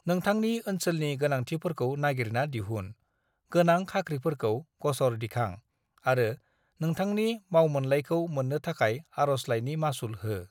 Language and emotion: Bodo, neutral